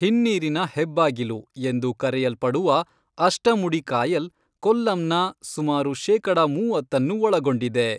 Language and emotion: Kannada, neutral